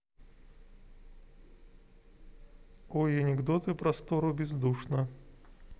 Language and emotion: Russian, neutral